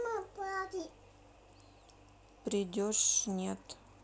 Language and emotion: Russian, sad